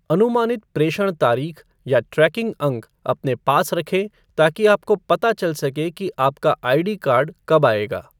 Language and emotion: Hindi, neutral